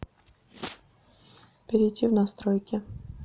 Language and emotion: Russian, neutral